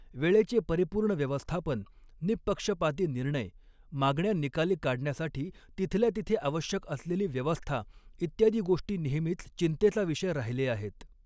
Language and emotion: Marathi, neutral